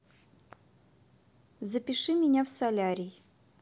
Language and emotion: Russian, neutral